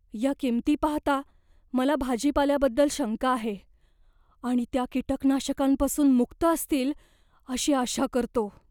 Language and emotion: Marathi, fearful